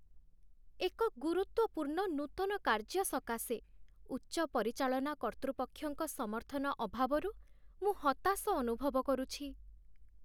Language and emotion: Odia, sad